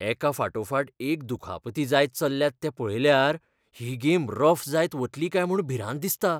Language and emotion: Goan Konkani, fearful